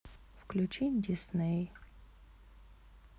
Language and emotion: Russian, sad